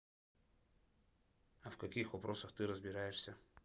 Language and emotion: Russian, neutral